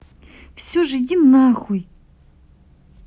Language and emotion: Russian, angry